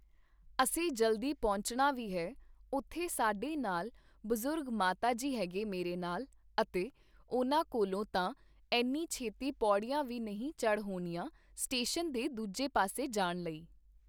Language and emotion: Punjabi, neutral